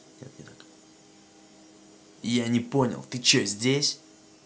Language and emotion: Russian, angry